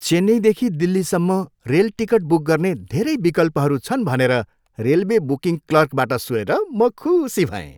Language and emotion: Nepali, happy